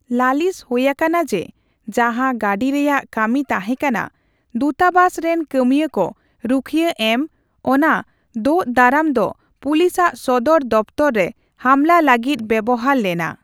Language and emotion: Santali, neutral